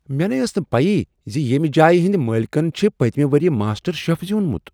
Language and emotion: Kashmiri, surprised